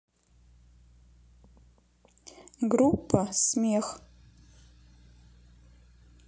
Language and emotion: Russian, neutral